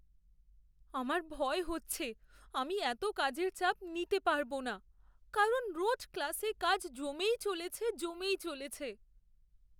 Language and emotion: Bengali, fearful